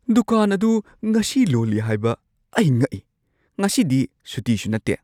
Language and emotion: Manipuri, surprised